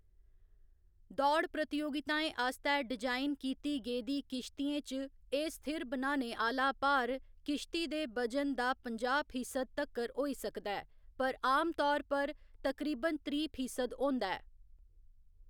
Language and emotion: Dogri, neutral